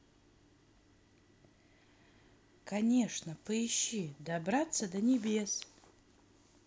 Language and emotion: Russian, neutral